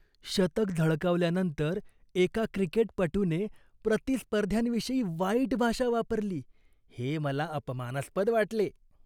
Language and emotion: Marathi, disgusted